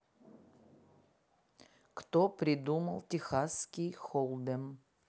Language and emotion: Russian, neutral